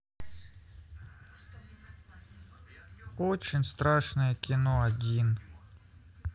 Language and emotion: Russian, sad